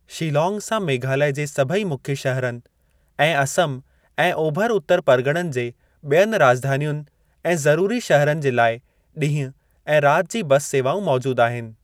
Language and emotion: Sindhi, neutral